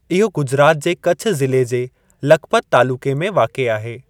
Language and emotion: Sindhi, neutral